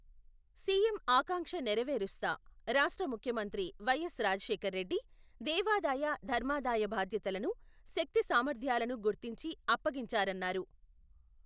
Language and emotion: Telugu, neutral